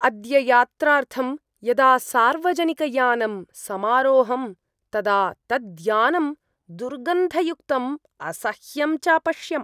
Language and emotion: Sanskrit, disgusted